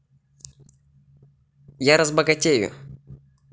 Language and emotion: Russian, positive